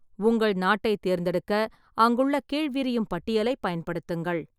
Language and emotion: Tamil, neutral